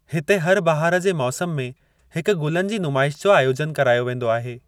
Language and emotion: Sindhi, neutral